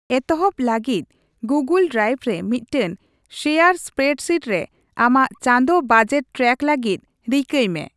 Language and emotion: Santali, neutral